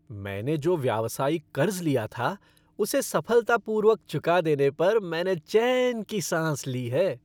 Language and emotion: Hindi, happy